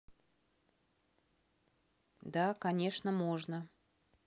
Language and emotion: Russian, neutral